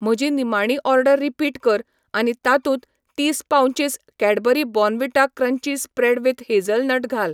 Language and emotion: Goan Konkani, neutral